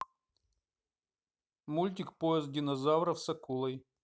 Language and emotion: Russian, neutral